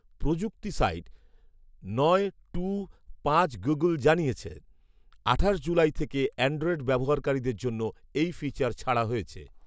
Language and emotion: Bengali, neutral